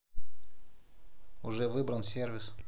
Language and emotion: Russian, neutral